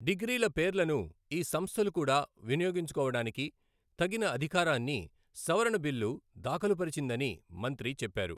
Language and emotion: Telugu, neutral